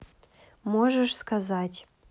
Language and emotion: Russian, neutral